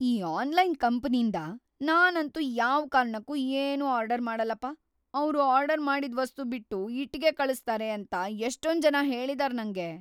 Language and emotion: Kannada, fearful